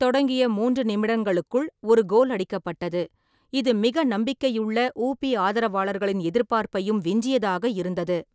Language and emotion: Tamil, neutral